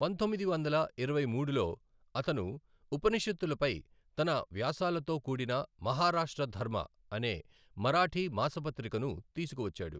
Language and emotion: Telugu, neutral